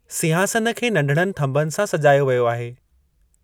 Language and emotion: Sindhi, neutral